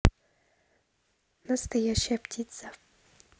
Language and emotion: Russian, neutral